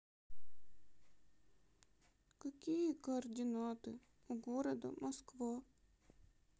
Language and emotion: Russian, sad